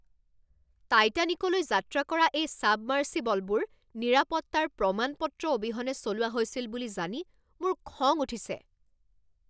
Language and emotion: Assamese, angry